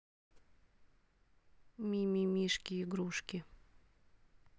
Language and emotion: Russian, neutral